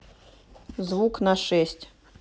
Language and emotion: Russian, neutral